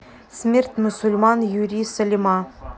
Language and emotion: Russian, neutral